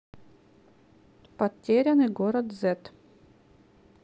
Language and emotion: Russian, neutral